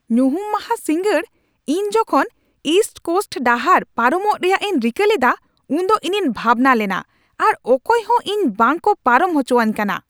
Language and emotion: Santali, angry